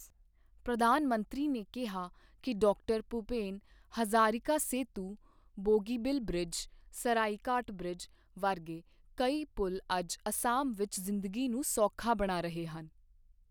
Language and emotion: Punjabi, neutral